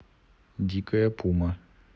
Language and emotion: Russian, neutral